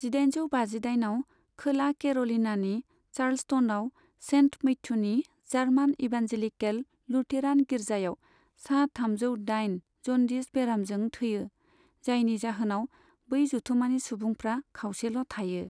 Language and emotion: Bodo, neutral